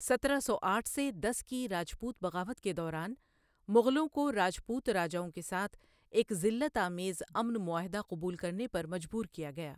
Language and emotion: Urdu, neutral